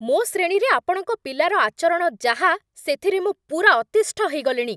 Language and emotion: Odia, angry